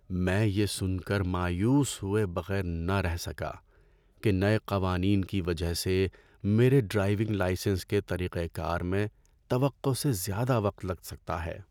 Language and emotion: Urdu, sad